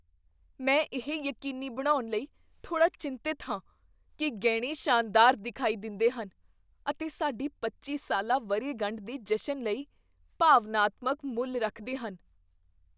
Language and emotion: Punjabi, fearful